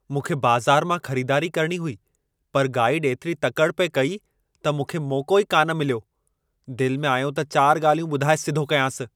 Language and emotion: Sindhi, angry